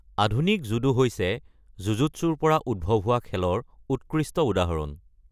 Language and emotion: Assamese, neutral